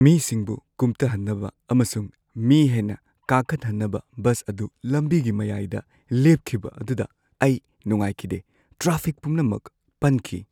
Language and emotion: Manipuri, sad